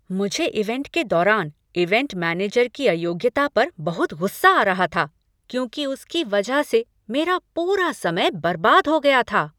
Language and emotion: Hindi, angry